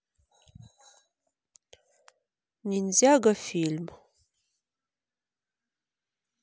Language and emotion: Russian, neutral